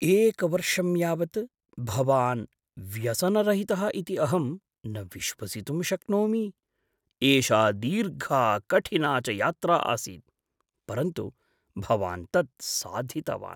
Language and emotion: Sanskrit, surprised